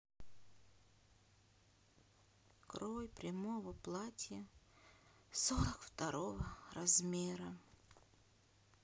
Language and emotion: Russian, sad